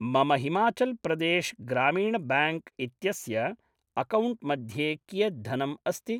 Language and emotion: Sanskrit, neutral